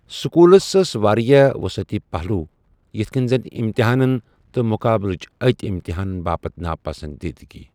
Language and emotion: Kashmiri, neutral